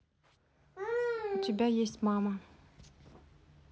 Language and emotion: Russian, neutral